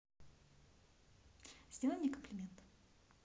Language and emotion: Russian, neutral